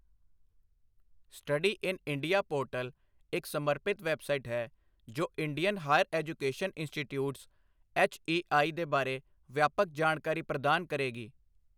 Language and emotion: Punjabi, neutral